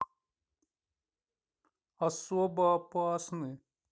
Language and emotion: Russian, sad